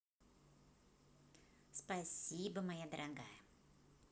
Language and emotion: Russian, positive